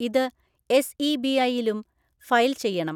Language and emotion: Malayalam, neutral